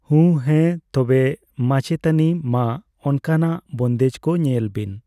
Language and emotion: Santali, neutral